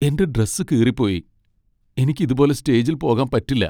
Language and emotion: Malayalam, sad